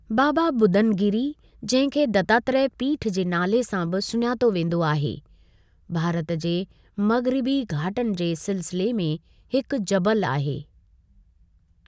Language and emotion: Sindhi, neutral